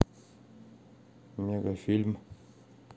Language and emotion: Russian, neutral